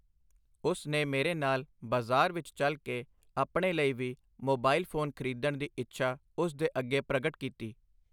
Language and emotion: Punjabi, neutral